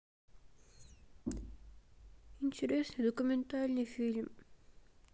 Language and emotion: Russian, sad